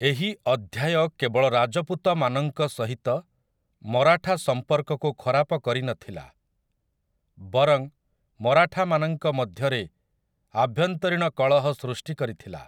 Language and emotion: Odia, neutral